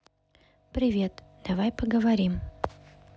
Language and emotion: Russian, neutral